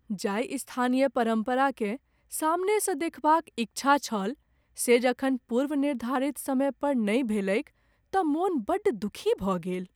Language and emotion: Maithili, sad